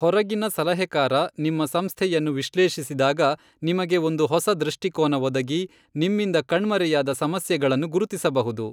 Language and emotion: Kannada, neutral